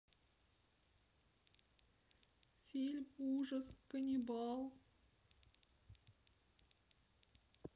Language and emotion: Russian, sad